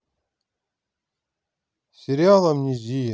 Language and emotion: Russian, neutral